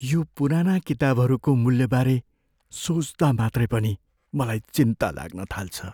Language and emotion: Nepali, fearful